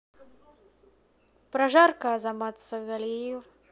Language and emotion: Russian, neutral